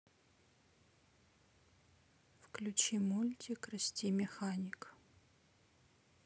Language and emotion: Russian, neutral